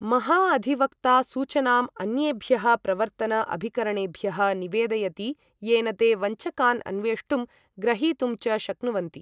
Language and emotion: Sanskrit, neutral